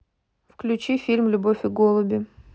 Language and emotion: Russian, neutral